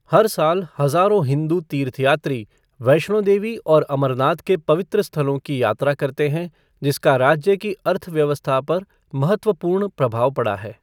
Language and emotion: Hindi, neutral